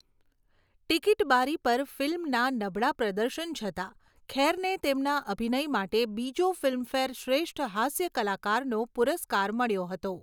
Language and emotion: Gujarati, neutral